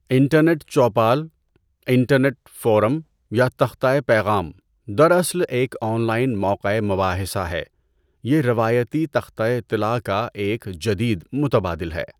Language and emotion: Urdu, neutral